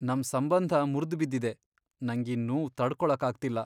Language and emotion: Kannada, sad